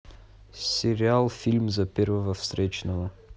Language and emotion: Russian, neutral